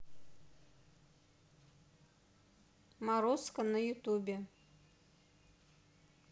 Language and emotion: Russian, neutral